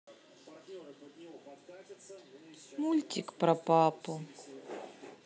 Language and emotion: Russian, sad